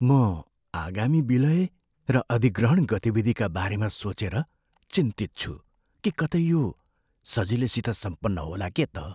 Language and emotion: Nepali, fearful